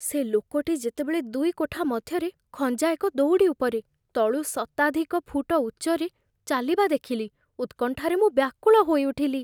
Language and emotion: Odia, fearful